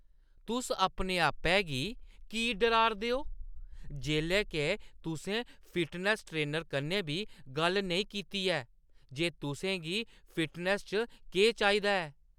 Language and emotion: Dogri, angry